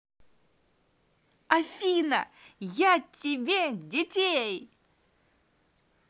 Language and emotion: Russian, positive